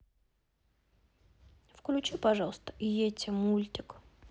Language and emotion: Russian, neutral